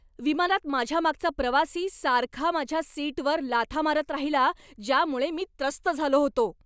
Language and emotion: Marathi, angry